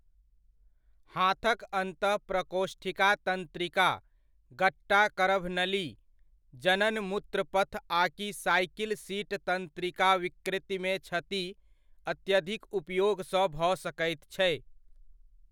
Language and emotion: Maithili, neutral